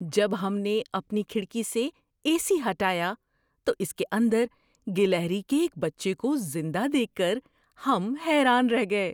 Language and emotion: Urdu, surprised